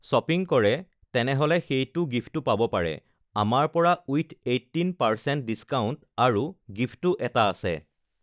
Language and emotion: Assamese, neutral